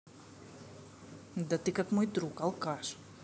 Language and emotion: Russian, angry